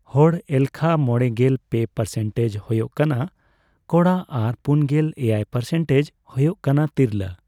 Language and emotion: Santali, neutral